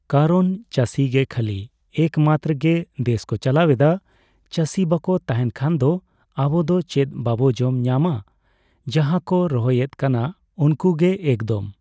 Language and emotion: Santali, neutral